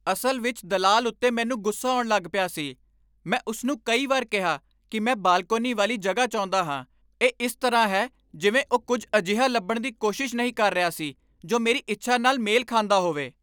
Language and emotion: Punjabi, angry